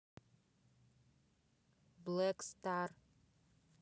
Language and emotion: Russian, neutral